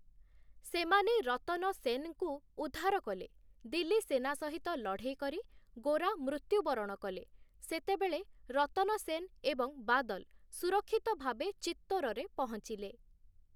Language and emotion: Odia, neutral